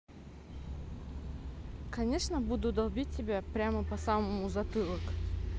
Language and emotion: Russian, neutral